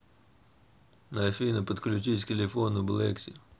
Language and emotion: Russian, neutral